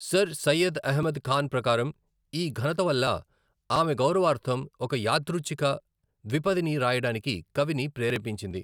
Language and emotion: Telugu, neutral